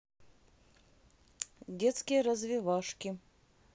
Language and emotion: Russian, neutral